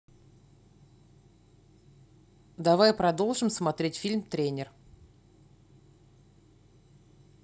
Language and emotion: Russian, neutral